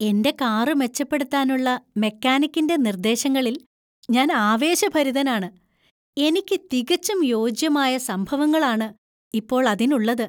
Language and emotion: Malayalam, happy